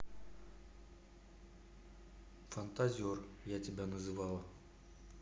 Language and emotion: Russian, neutral